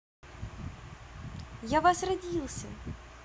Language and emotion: Russian, positive